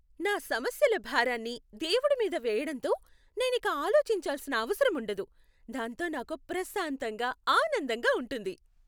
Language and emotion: Telugu, happy